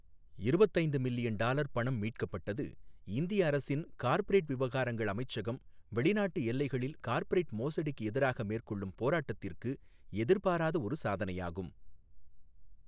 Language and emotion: Tamil, neutral